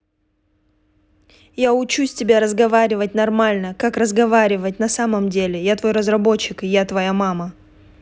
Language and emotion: Russian, angry